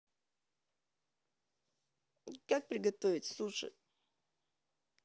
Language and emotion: Russian, neutral